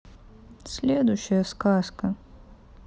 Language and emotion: Russian, sad